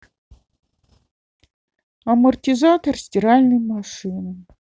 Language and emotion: Russian, sad